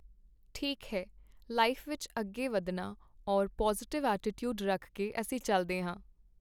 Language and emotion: Punjabi, neutral